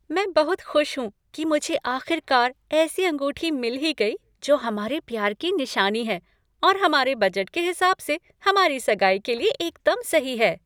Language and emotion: Hindi, happy